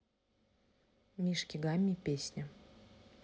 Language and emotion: Russian, neutral